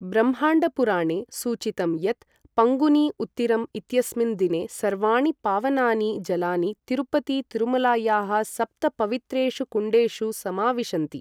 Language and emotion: Sanskrit, neutral